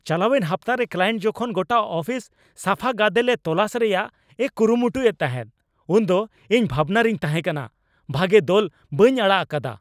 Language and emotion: Santali, angry